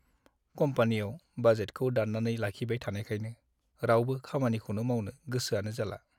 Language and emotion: Bodo, sad